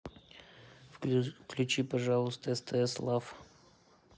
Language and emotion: Russian, neutral